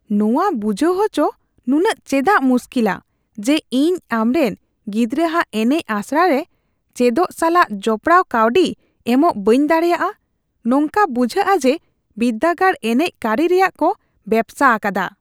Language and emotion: Santali, disgusted